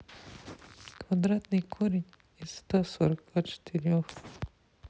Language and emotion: Russian, sad